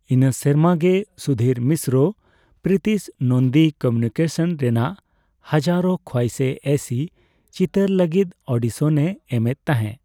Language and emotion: Santali, neutral